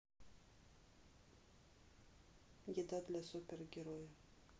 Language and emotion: Russian, neutral